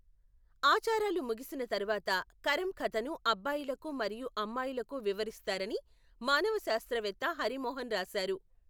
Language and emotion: Telugu, neutral